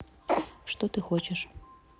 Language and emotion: Russian, neutral